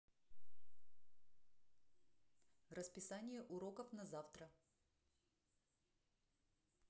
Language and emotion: Russian, neutral